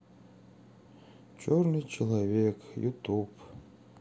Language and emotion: Russian, sad